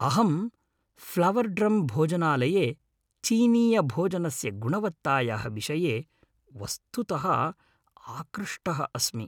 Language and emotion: Sanskrit, happy